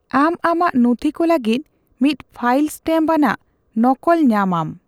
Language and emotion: Santali, neutral